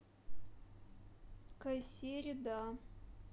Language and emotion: Russian, neutral